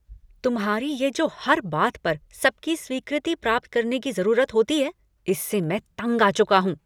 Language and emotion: Hindi, angry